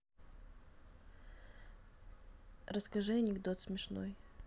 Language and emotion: Russian, neutral